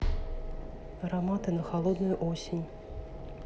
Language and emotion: Russian, neutral